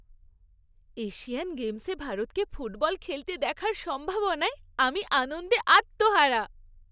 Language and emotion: Bengali, happy